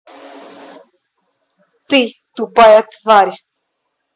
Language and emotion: Russian, angry